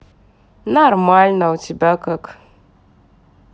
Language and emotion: Russian, neutral